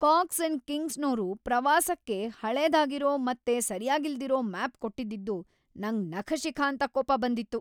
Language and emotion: Kannada, angry